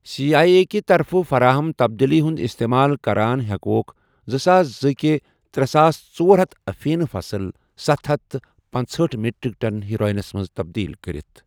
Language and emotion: Kashmiri, neutral